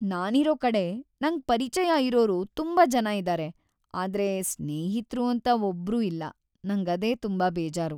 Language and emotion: Kannada, sad